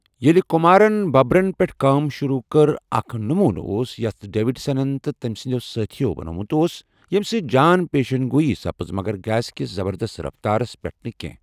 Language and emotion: Kashmiri, neutral